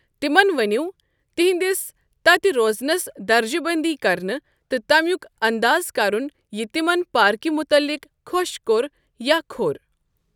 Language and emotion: Kashmiri, neutral